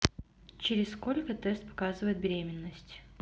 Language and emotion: Russian, neutral